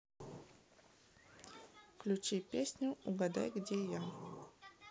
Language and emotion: Russian, neutral